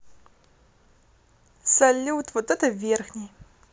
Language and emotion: Russian, positive